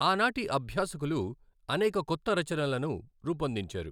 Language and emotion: Telugu, neutral